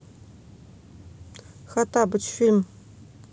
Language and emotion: Russian, neutral